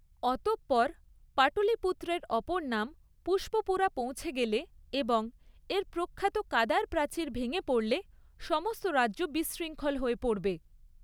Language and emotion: Bengali, neutral